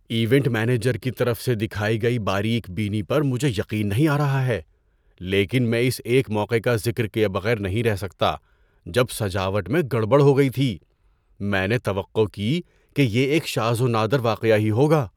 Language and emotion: Urdu, surprised